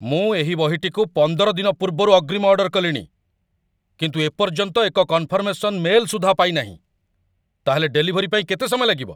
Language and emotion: Odia, angry